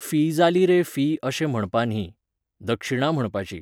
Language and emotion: Goan Konkani, neutral